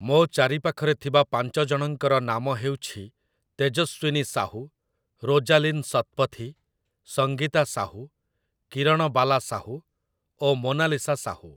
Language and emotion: Odia, neutral